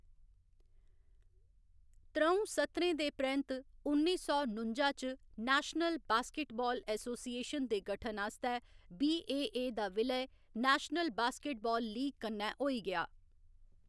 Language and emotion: Dogri, neutral